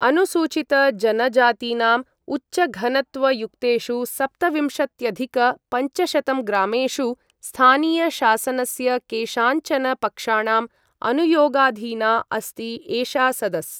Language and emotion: Sanskrit, neutral